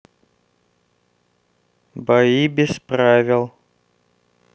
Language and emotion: Russian, neutral